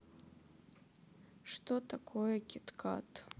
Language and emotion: Russian, sad